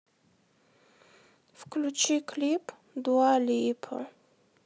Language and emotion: Russian, sad